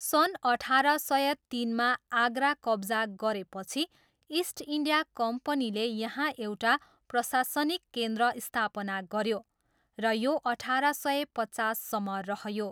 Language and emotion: Nepali, neutral